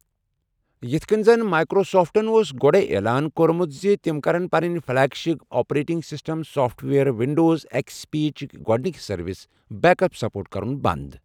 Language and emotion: Kashmiri, neutral